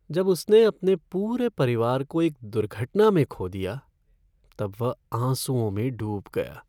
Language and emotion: Hindi, sad